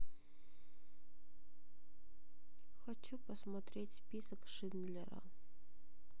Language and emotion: Russian, sad